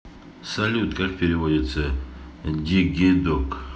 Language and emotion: Russian, neutral